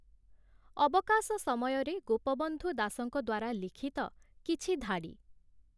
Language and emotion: Odia, neutral